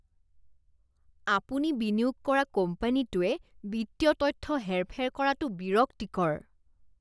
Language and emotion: Assamese, disgusted